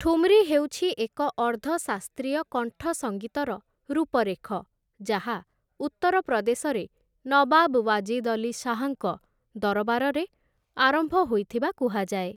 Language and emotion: Odia, neutral